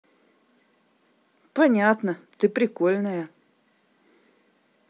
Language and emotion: Russian, positive